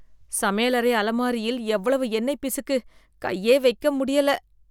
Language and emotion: Tamil, disgusted